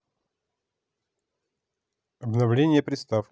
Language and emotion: Russian, neutral